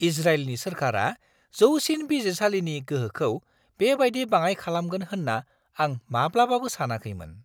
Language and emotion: Bodo, surprised